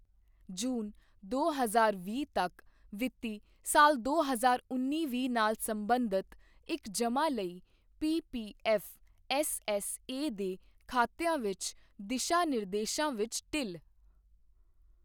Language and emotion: Punjabi, neutral